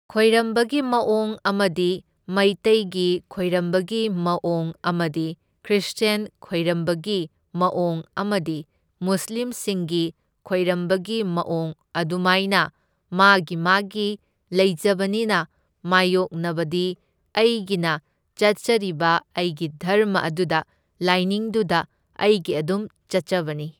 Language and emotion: Manipuri, neutral